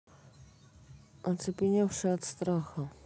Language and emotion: Russian, neutral